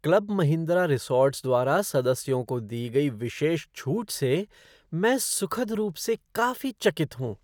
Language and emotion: Hindi, surprised